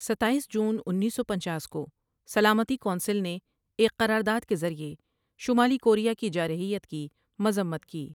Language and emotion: Urdu, neutral